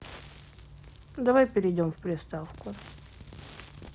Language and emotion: Russian, neutral